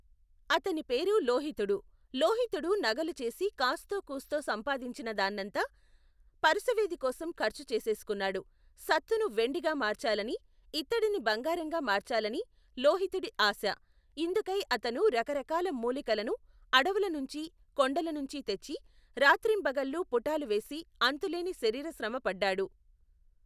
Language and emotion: Telugu, neutral